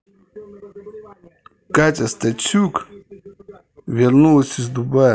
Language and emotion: Russian, neutral